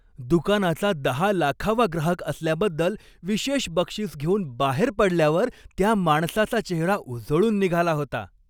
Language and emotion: Marathi, happy